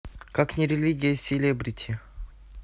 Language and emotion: Russian, neutral